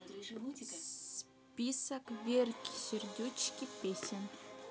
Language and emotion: Russian, neutral